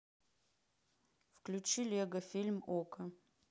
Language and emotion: Russian, neutral